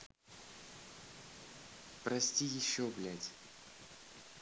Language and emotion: Russian, angry